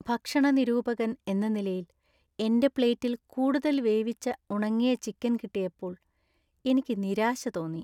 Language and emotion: Malayalam, sad